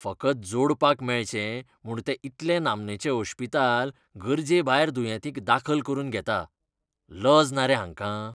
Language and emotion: Goan Konkani, disgusted